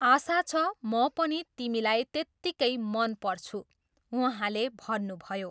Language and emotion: Nepali, neutral